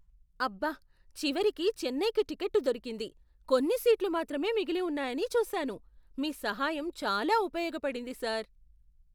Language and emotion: Telugu, surprised